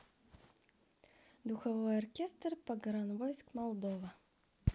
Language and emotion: Russian, neutral